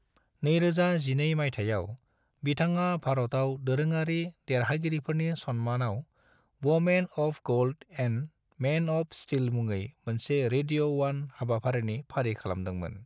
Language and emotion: Bodo, neutral